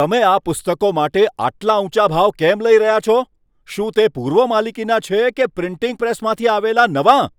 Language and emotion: Gujarati, angry